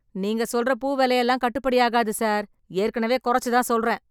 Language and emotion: Tamil, angry